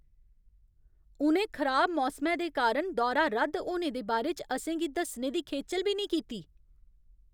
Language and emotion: Dogri, angry